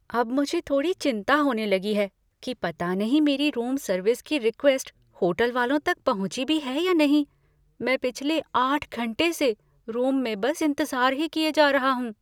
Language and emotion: Hindi, fearful